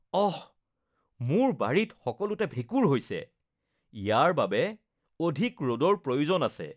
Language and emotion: Assamese, disgusted